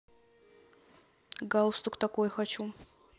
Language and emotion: Russian, neutral